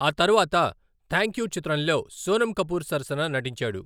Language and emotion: Telugu, neutral